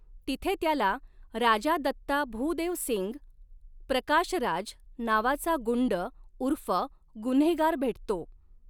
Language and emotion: Marathi, neutral